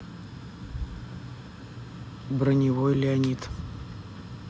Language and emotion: Russian, neutral